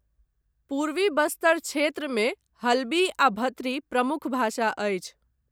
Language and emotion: Maithili, neutral